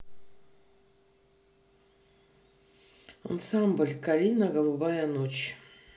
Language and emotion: Russian, neutral